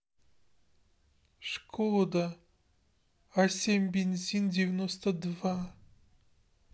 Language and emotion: Russian, sad